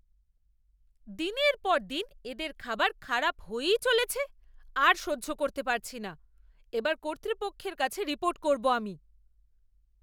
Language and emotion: Bengali, angry